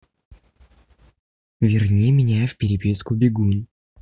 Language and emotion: Russian, neutral